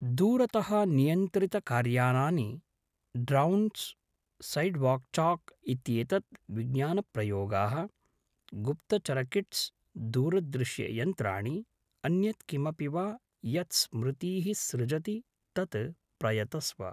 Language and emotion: Sanskrit, neutral